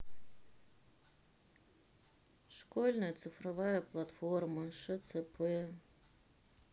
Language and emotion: Russian, sad